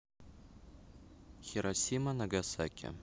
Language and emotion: Russian, neutral